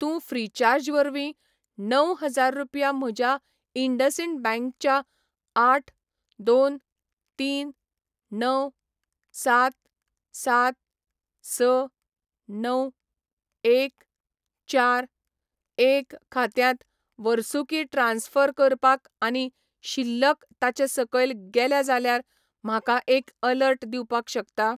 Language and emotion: Goan Konkani, neutral